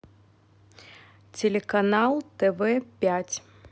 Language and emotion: Russian, neutral